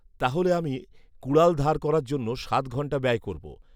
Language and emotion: Bengali, neutral